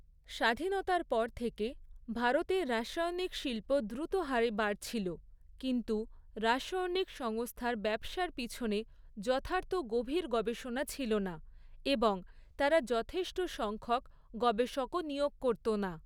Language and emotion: Bengali, neutral